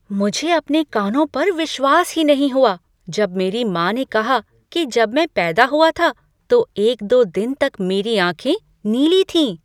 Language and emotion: Hindi, surprised